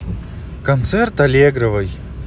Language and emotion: Russian, neutral